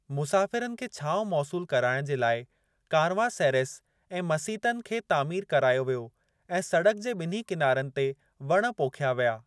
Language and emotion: Sindhi, neutral